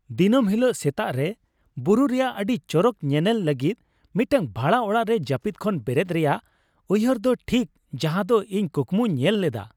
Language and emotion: Santali, happy